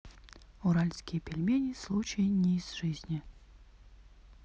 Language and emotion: Russian, neutral